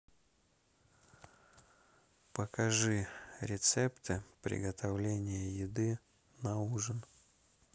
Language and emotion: Russian, neutral